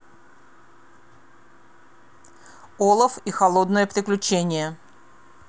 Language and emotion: Russian, neutral